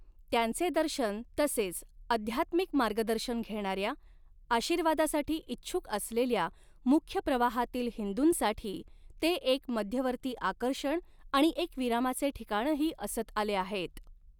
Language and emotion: Marathi, neutral